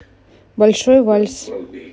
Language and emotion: Russian, neutral